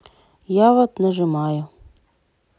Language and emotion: Russian, sad